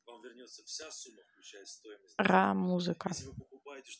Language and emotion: Russian, neutral